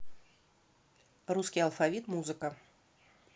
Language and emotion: Russian, neutral